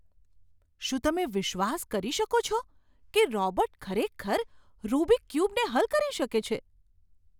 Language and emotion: Gujarati, surprised